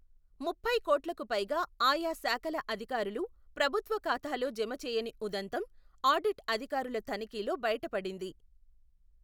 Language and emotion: Telugu, neutral